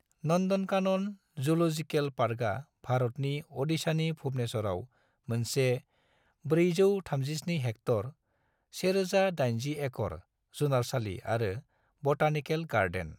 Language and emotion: Bodo, neutral